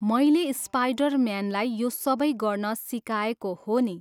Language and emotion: Nepali, neutral